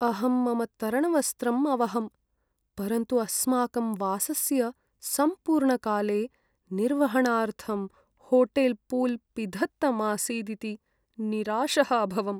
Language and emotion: Sanskrit, sad